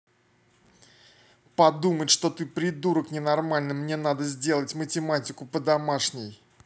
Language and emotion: Russian, angry